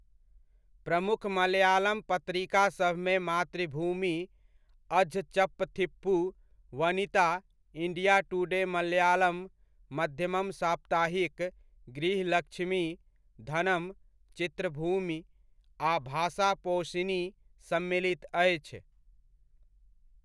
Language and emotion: Maithili, neutral